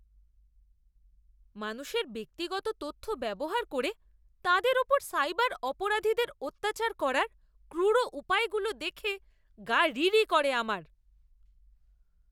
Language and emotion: Bengali, disgusted